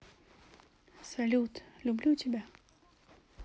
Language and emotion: Russian, neutral